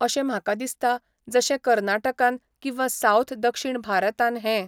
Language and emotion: Goan Konkani, neutral